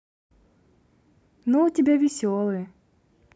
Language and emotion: Russian, positive